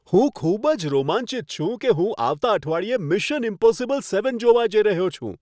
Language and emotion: Gujarati, happy